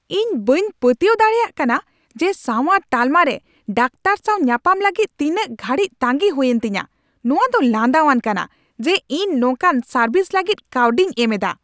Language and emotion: Santali, angry